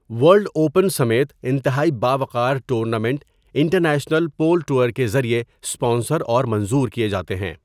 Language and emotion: Urdu, neutral